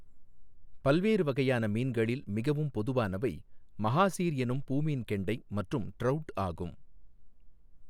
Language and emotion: Tamil, neutral